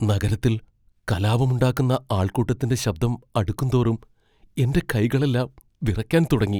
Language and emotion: Malayalam, fearful